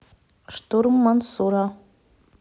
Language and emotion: Russian, neutral